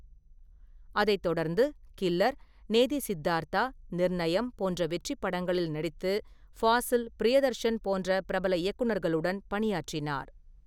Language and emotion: Tamil, neutral